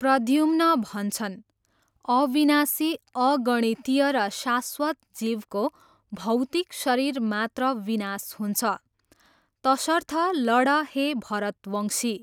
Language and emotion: Nepali, neutral